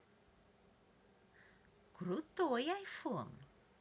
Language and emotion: Russian, positive